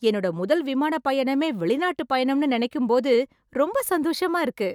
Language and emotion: Tamil, happy